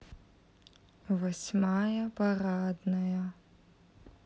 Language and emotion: Russian, neutral